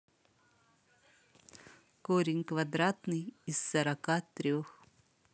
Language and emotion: Russian, neutral